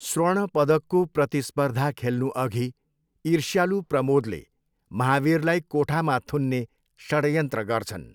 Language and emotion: Nepali, neutral